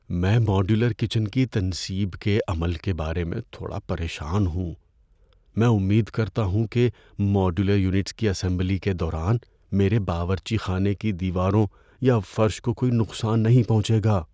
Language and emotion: Urdu, fearful